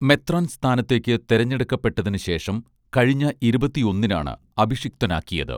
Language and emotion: Malayalam, neutral